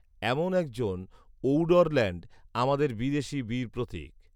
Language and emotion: Bengali, neutral